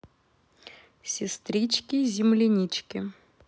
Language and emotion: Russian, positive